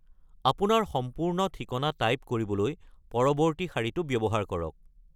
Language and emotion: Assamese, neutral